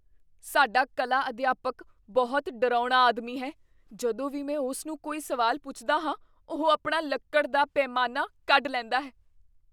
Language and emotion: Punjabi, fearful